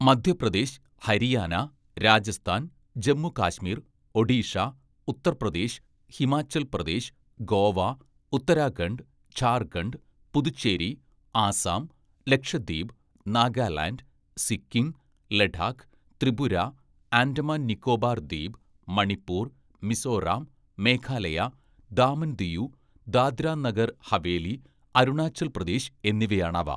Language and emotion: Malayalam, neutral